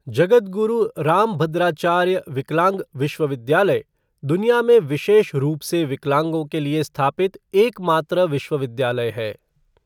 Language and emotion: Hindi, neutral